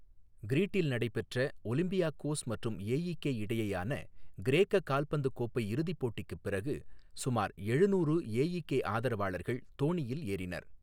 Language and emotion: Tamil, neutral